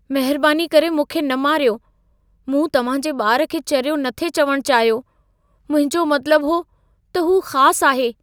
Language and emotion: Sindhi, fearful